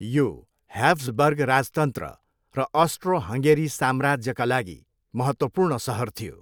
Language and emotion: Nepali, neutral